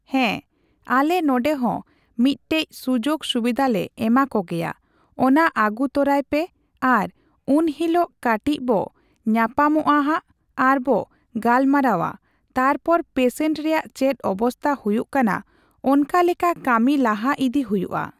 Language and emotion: Santali, neutral